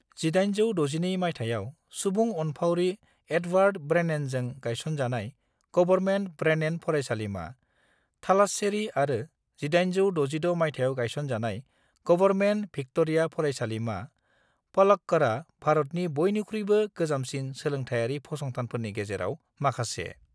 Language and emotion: Bodo, neutral